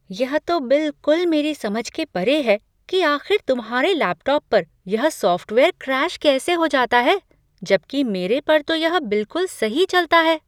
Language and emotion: Hindi, surprised